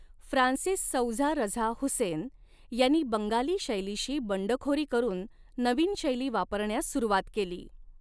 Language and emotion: Marathi, neutral